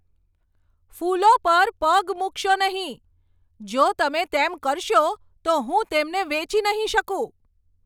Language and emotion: Gujarati, angry